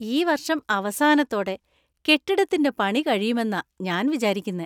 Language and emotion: Malayalam, happy